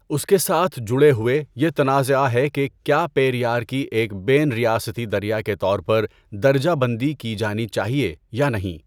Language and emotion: Urdu, neutral